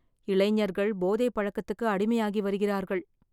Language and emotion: Tamil, sad